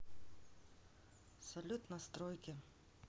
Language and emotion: Russian, neutral